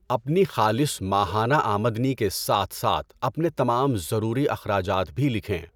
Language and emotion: Urdu, neutral